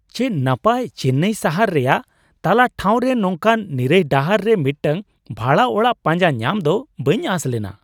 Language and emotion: Santali, surprised